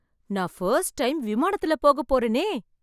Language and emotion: Tamil, surprised